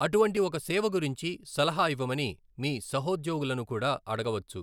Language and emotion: Telugu, neutral